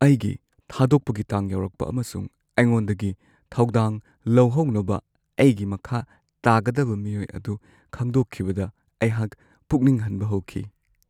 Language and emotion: Manipuri, sad